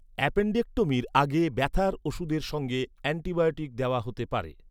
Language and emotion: Bengali, neutral